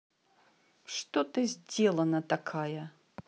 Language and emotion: Russian, angry